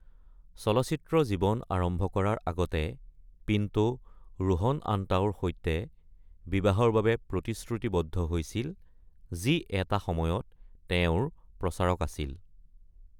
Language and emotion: Assamese, neutral